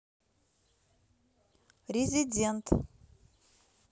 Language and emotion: Russian, neutral